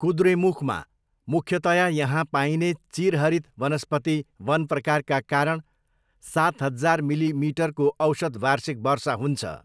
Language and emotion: Nepali, neutral